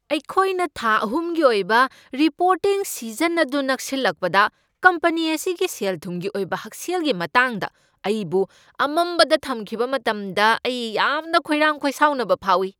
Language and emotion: Manipuri, angry